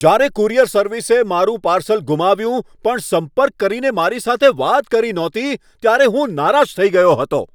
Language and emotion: Gujarati, angry